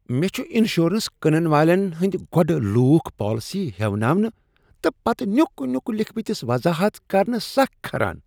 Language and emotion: Kashmiri, disgusted